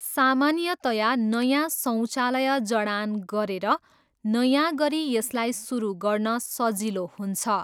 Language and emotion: Nepali, neutral